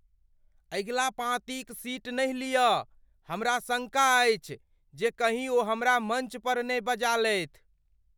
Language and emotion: Maithili, fearful